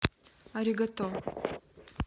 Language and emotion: Russian, neutral